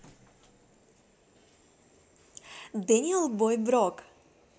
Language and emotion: Russian, positive